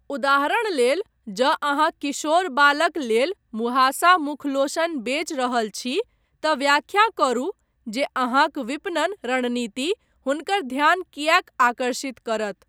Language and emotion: Maithili, neutral